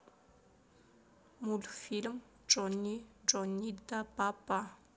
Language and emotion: Russian, neutral